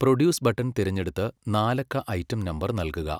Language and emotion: Malayalam, neutral